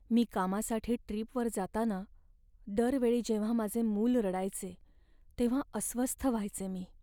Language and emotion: Marathi, sad